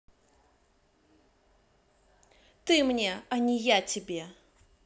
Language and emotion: Russian, angry